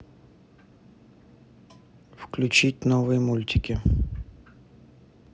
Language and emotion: Russian, neutral